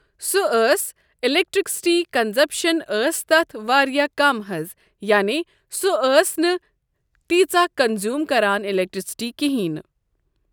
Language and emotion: Kashmiri, neutral